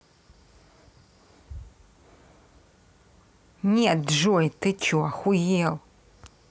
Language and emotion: Russian, angry